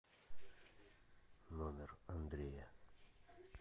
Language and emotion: Russian, neutral